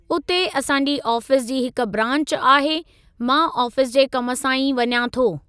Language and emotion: Sindhi, neutral